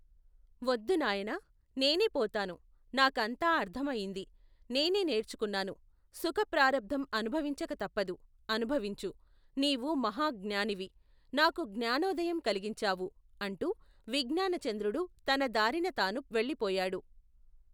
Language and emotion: Telugu, neutral